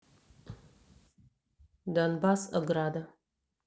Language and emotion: Russian, neutral